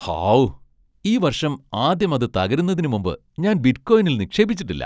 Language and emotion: Malayalam, happy